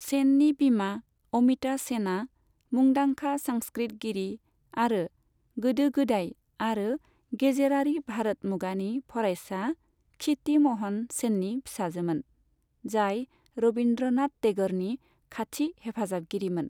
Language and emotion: Bodo, neutral